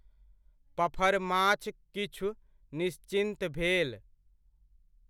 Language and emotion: Maithili, neutral